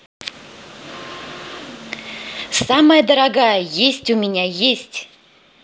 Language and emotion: Russian, positive